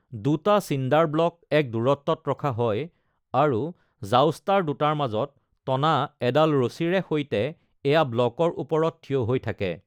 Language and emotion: Assamese, neutral